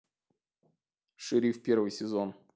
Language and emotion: Russian, neutral